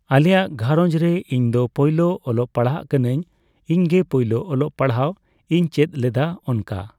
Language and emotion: Santali, neutral